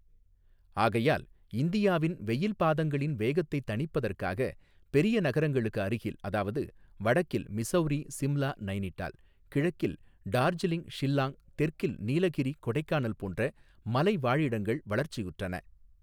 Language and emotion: Tamil, neutral